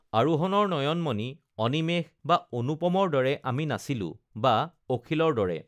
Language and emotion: Assamese, neutral